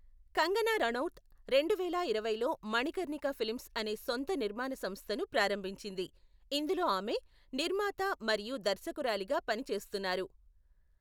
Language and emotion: Telugu, neutral